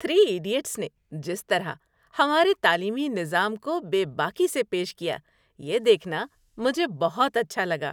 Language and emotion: Urdu, happy